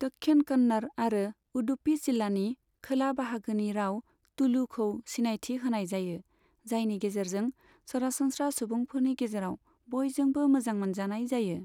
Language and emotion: Bodo, neutral